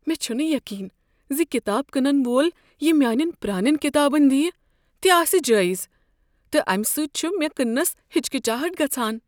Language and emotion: Kashmiri, fearful